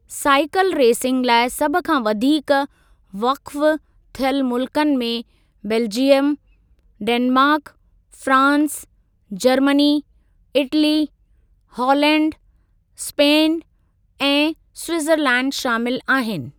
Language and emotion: Sindhi, neutral